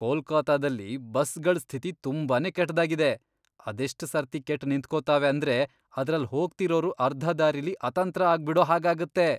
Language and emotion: Kannada, disgusted